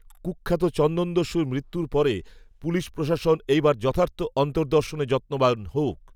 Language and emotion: Bengali, neutral